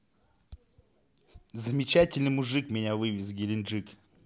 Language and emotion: Russian, positive